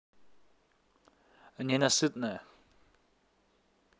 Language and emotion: Russian, neutral